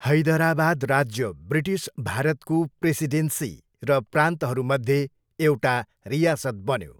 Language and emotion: Nepali, neutral